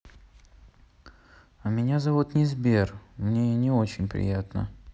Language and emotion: Russian, sad